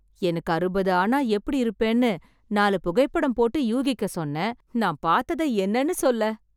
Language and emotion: Tamil, surprised